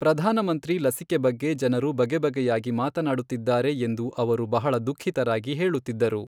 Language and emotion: Kannada, neutral